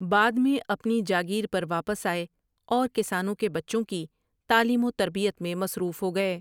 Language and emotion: Urdu, neutral